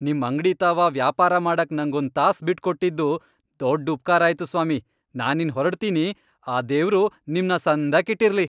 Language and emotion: Kannada, happy